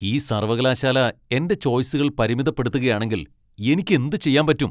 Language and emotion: Malayalam, angry